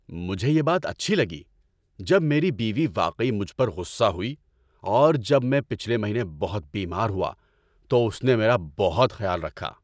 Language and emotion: Urdu, happy